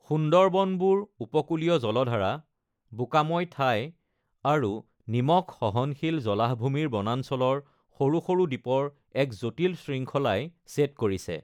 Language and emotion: Assamese, neutral